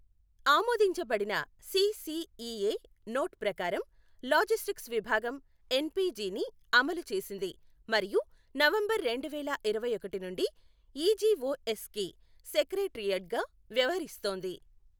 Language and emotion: Telugu, neutral